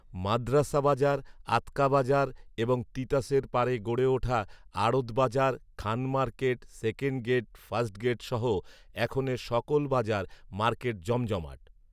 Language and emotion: Bengali, neutral